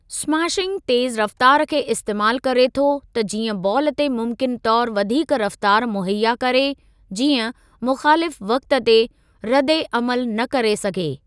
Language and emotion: Sindhi, neutral